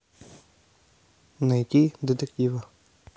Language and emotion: Russian, neutral